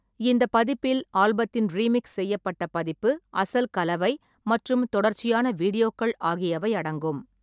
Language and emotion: Tamil, neutral